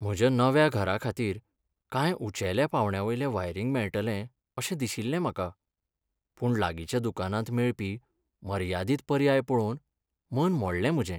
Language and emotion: Goan Konkani, sad